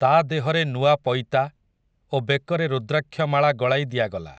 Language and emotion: Odia, neutral